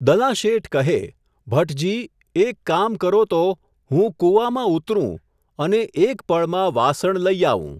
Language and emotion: Gujarati, neutral